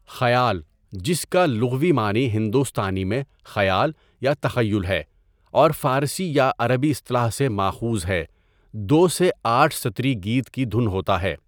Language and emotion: Urdu, neutral